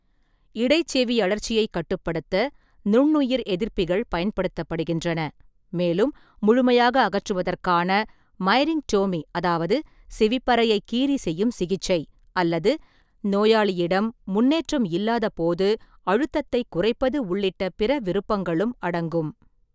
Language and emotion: Tamil, neutral